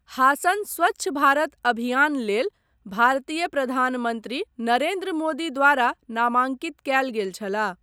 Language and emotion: Maithili, neutral